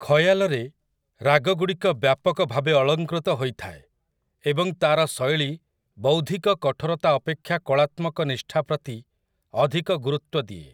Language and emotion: Odia, neutral